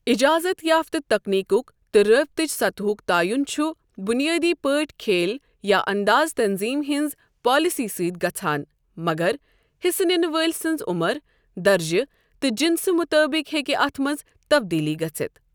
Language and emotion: Kashmiri, neutral